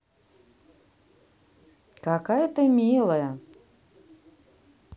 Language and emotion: Russian, positive